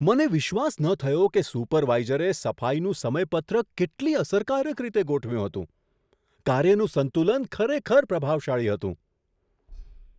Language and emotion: Gujarati, surprised